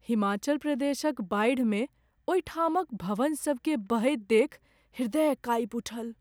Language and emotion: Maithili, sad